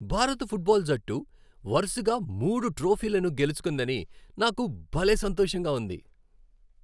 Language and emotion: Telugu, happy